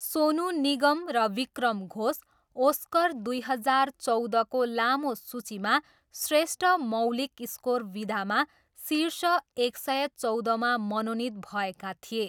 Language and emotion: Nepali, neutral